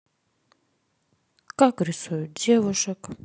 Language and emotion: Russian, sad